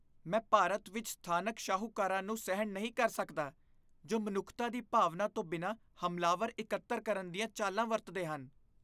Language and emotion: Punjabi, disgusted